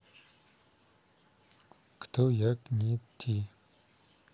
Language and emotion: Russian, neutral